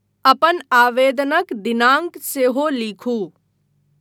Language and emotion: Maithili, neutral